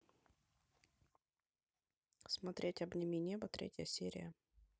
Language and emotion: Russian, neutral